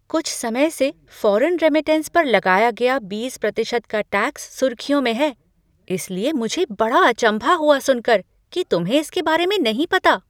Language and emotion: Hindi, surprised